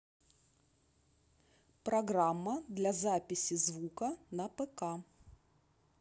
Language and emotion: Russian, neutral